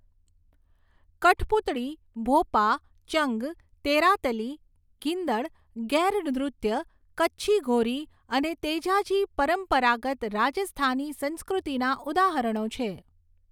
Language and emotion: Gujarati, neutral